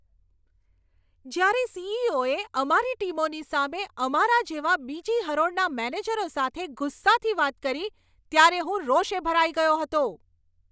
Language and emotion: Gujarati, angry